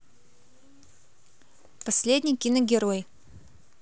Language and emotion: Russian, neutral